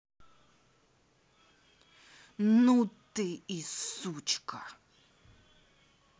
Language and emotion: Russian, angry